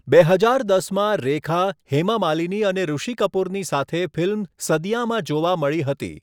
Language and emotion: Gujarati, neutral